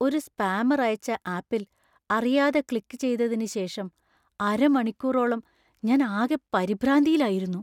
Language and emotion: Malayalam, fearful